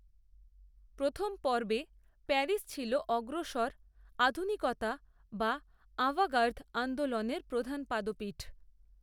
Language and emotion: Bengali, neutral